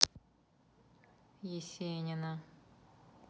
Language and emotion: Russian, neutral